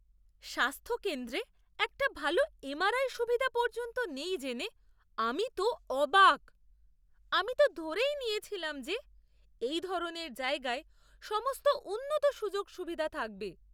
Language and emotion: Bengali, surprised